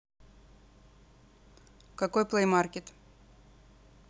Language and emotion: Russian, neutral